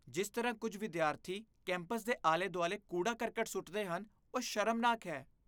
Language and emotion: Punjabi, disgusted